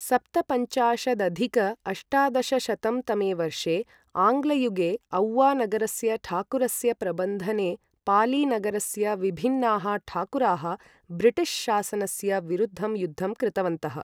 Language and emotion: Sanskrit, neutral